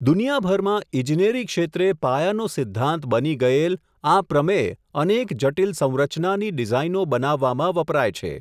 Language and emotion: Gujarati, neutral